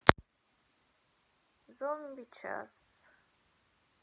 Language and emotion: Russian, sad